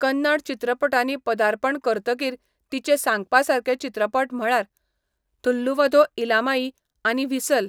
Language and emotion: Goan Konkani, neutral